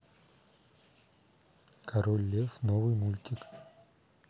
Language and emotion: Russian, neutral